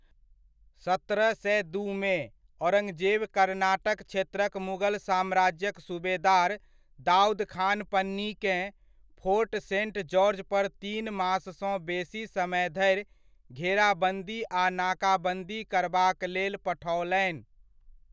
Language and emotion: Maithili, neutral